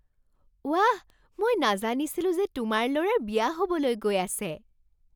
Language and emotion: Assamese, surprised